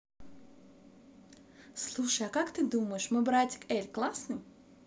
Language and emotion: Russian, positive